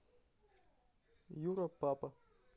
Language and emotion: Russian, neutral